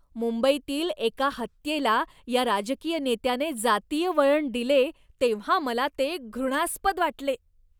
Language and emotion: Marathi, disgusted